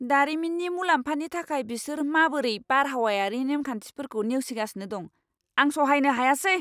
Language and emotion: Bodo, angry